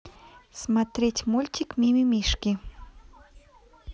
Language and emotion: Russian, neutral